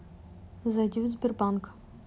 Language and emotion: Russian, neutral